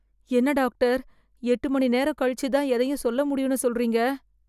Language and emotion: Tamil, fearful